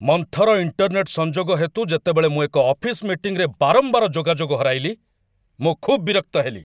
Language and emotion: Odia, angry